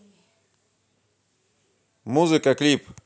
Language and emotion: Russian, neutral